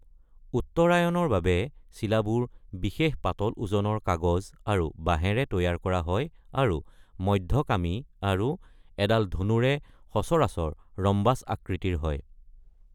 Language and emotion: Assamese, neutral